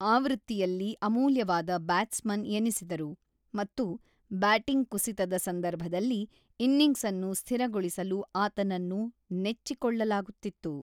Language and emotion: Kannada, neutral